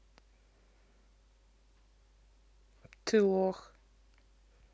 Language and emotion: Russian, neutral